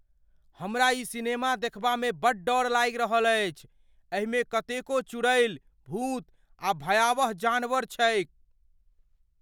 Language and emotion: Maithili, fearful